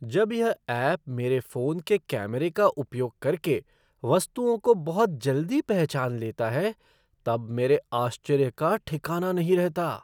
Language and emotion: Hindi, surprised